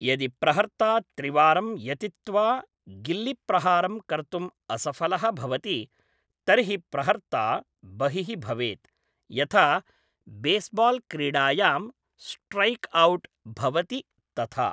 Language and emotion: Sanskrit, neutral